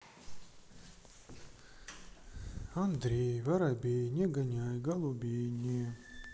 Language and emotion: Russian, neutral